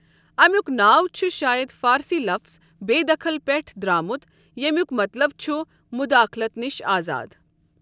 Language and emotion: Kashmiri, neutral